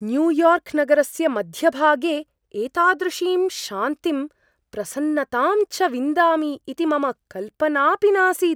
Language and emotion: Sanskrit, surprised